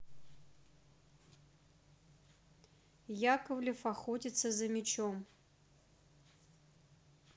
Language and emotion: Russian, neutral